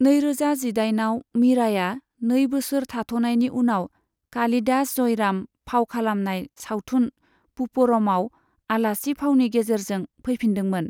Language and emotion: Bodo, neutral